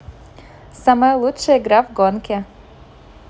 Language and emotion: Russian, positive